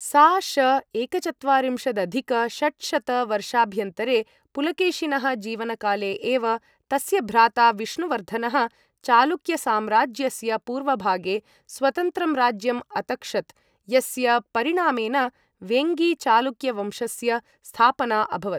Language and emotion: Sanskrit, neutral